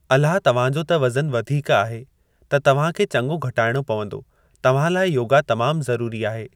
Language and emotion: Sindhi, neutral